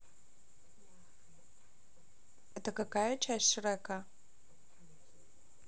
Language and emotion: Russian, neutral